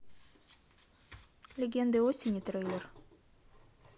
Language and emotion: Russian, neutral